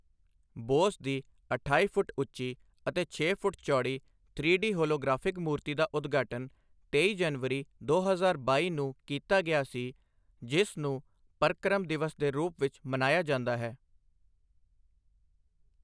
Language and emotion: Punjabi, neutral